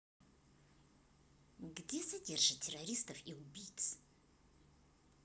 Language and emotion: Russian, neutral